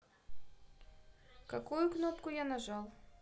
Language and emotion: Russian, neutral